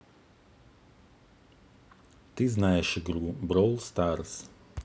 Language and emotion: Russian, neutral